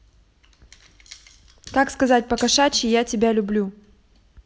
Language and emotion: Russian, neutral